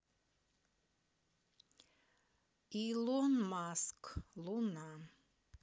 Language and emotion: Russian, neutral